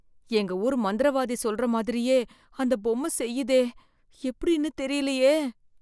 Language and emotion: Tamil, fearful